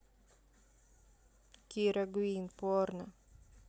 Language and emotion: Russian, neutral